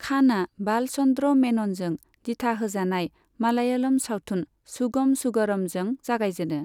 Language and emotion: Bodo, neutral